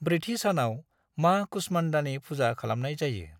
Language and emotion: Bodo, neutral